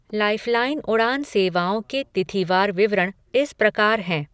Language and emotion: Hindi, neutral